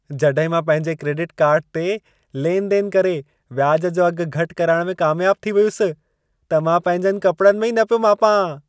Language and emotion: Sindhi, happy